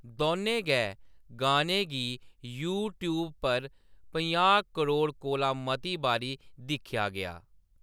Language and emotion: Dogri, neutral